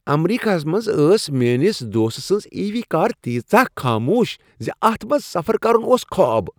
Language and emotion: Kashmiri, happy